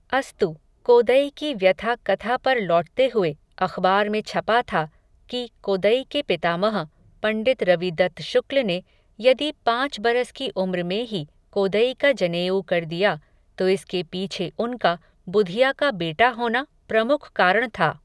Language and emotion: Hindi, neutral